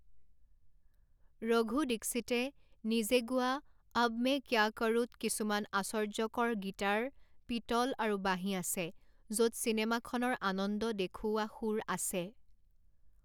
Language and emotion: Assamese, neutral